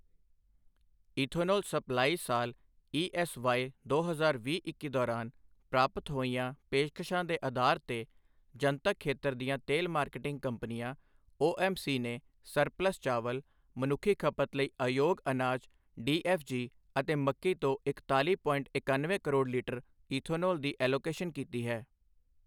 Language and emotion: Punjabi, neutral